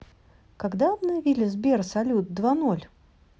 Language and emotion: Russian, neutral